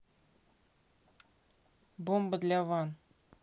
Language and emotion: Russian, neutral